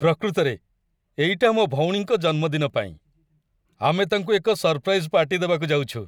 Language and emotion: Odia, happy